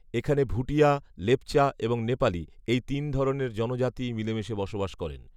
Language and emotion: Bengali, neutral